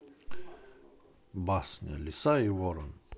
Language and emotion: Russian, neutral